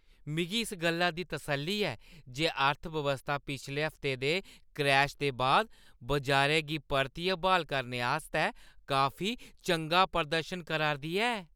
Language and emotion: Dogri, happy